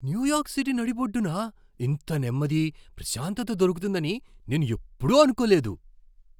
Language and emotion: Telugu, surprised